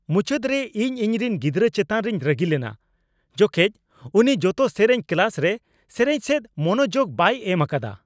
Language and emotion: Santali, angry